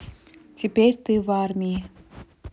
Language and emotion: Russian, neutral